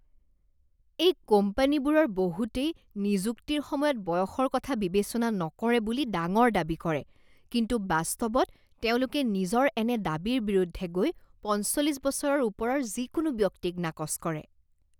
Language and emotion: Assamese, disgusted